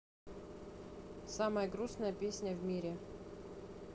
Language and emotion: Russian, neutral